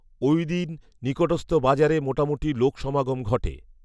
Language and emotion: Bengali, neutral